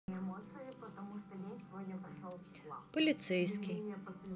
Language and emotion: Russian, neutral